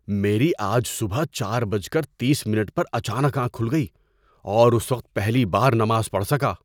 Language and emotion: Urdu, surprised